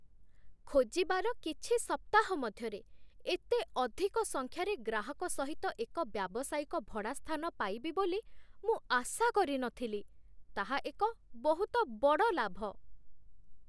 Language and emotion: Odia, surprised